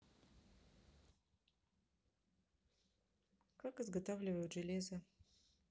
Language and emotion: Russian, neutral